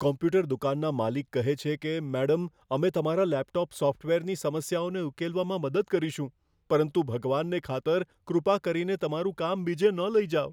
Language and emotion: Gujarati, fearful